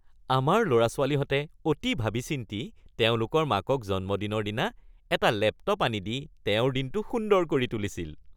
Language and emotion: Assamese, happy